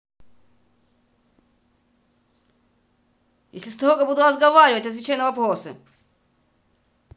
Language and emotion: Russian, angry